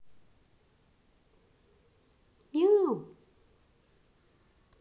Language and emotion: Russian, neutral